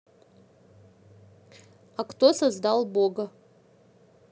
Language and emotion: Russian, neutral